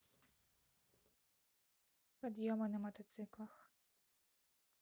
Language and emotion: Russian, neutral